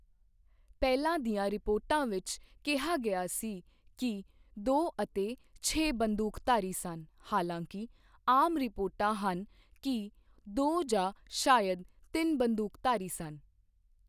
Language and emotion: Punjabi, neutral